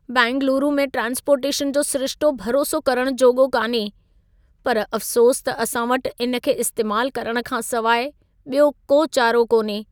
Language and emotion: Sindhi, sad